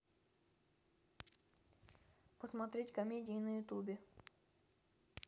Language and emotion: Russian, neutral